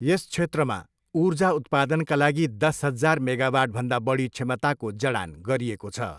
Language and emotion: Nepali, neutral